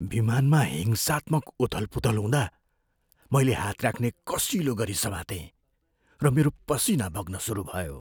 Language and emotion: Nepali, fearful